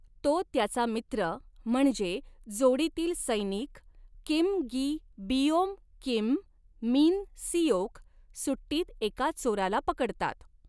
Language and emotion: Marathi, neutral